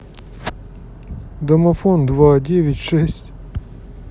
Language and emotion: Russian, sad